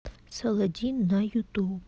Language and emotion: Russian, neutral